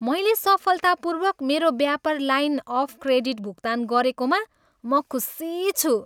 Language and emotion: Nepali, happy